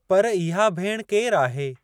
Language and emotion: Sindhi, neutral